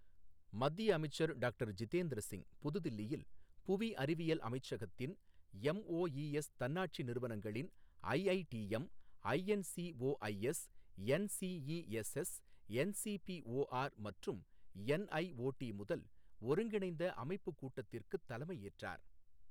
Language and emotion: Tamil, neutral